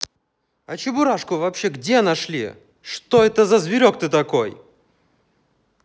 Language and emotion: Russian, angry